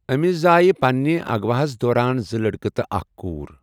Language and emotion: Kashmiri, neutral